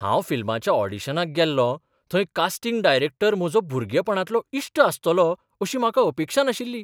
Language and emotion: Goan Konkani, surprised